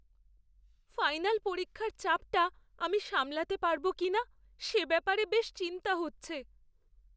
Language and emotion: Bengali, fearful